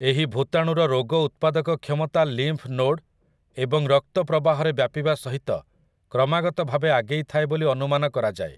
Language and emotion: Odia, neutral